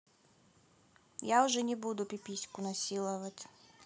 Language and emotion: Russian, neutral